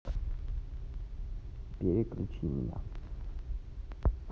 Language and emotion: Russian, neutral